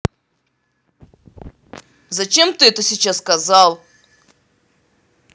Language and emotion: Russian, angry